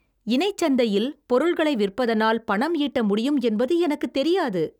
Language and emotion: Tamil, surprised